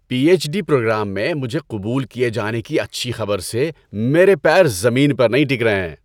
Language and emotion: Urdu, happy